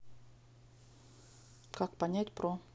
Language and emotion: Russian, neutral